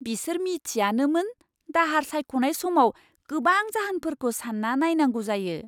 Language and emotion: Bodo, surprised